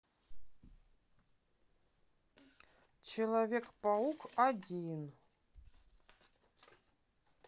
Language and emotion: Russian, neutral